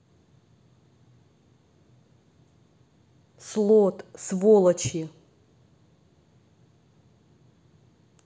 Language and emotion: Russian, angry